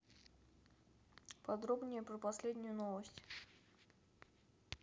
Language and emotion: Russian, neutral